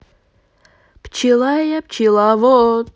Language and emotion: Russian, positive